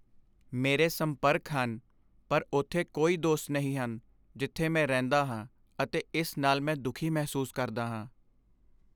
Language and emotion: Punjabi, sad